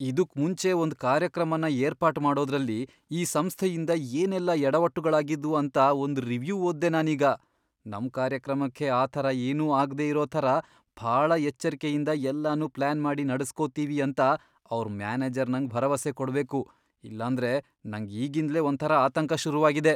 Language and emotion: Kannada, fearful